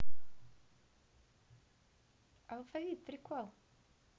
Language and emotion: Russian, positive